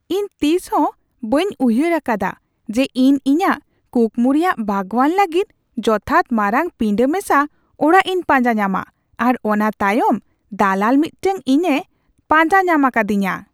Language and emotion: Santali, surprised